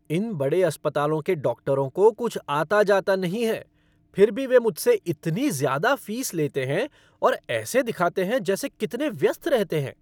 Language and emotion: Hindi, angry